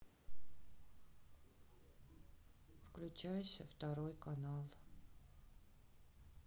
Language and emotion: Russian, sad